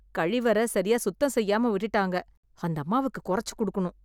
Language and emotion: Tamil, disgusted